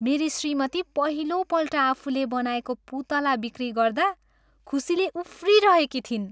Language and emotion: Nepali, happy